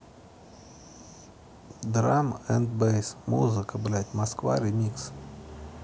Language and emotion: Russian, neutral